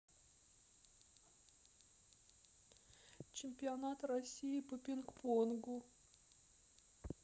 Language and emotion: Russian, sad